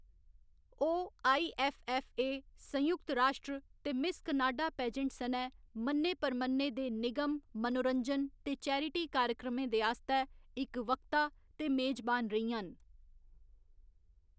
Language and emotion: Dogri, neutral